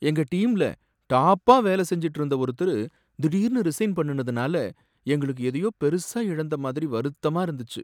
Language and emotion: Tamil, sad